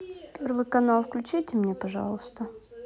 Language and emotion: Russian, neutral